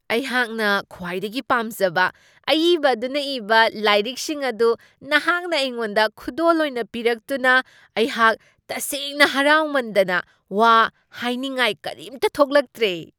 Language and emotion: Manipuri, surprised